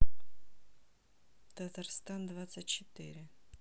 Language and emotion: Russian, neutral